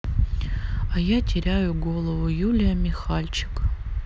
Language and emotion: Russian, sad